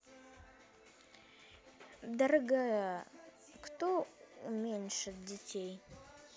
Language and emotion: Russian, neutral